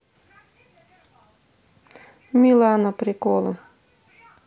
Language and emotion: Russian, neutral